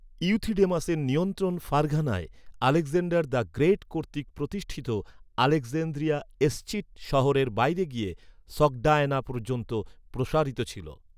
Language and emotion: Bengali, neutral